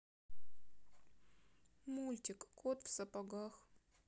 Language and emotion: Russian, sad